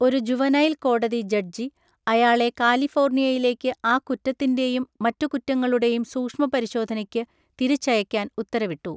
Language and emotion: Malayalam, neutral